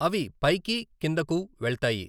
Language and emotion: Telugu, neutral